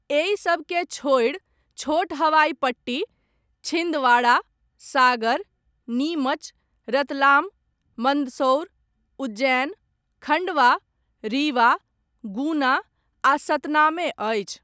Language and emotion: Maithili, neutral